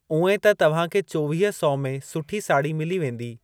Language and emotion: Sindhi, neutral